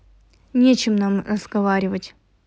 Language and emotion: Russian, neutral